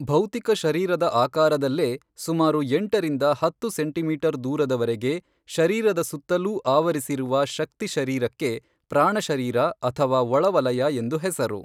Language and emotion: Kannada, neutral